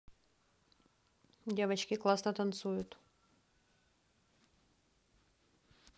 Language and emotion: Russian, neutral